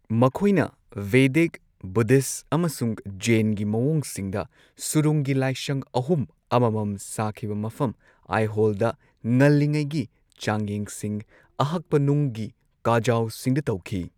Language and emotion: Manipuri, neutral